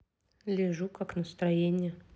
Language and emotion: Russian, neutral